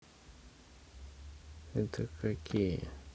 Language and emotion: Russian, neutral